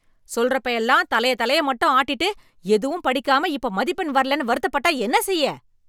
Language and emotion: Tamil, angry